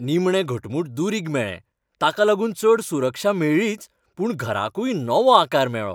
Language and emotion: Goan Konkani, happy